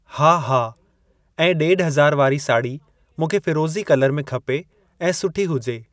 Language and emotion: Sindhi, neutral